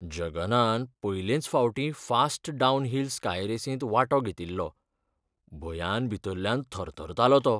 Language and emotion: Goan Konkani, fearful